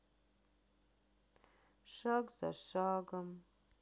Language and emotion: Russian, sad